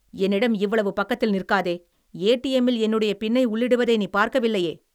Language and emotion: Tamil, angry